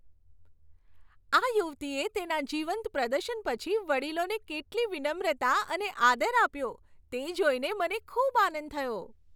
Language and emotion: Gujarati, happy